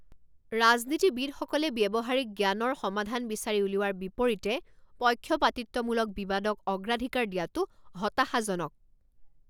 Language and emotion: Assamese, angry